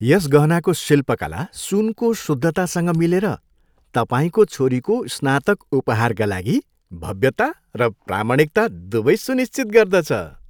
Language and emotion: Nepali, happy